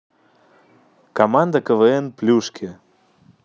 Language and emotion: Russian, neutral